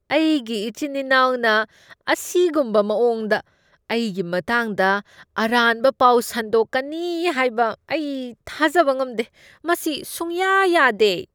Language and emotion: Manipuri, disgusted